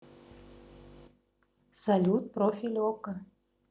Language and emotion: Russian, neutral